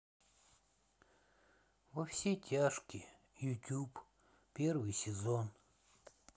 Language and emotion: Russian, sad